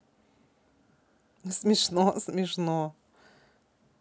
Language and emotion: Russian, positive